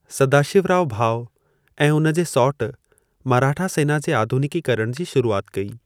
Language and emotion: Sindhi, neutral